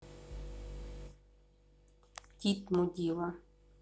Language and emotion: Russian, neutral